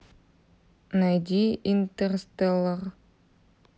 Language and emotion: Russian, neutral